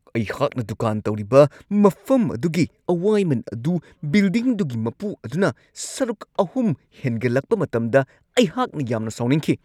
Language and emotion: Manipuri, angry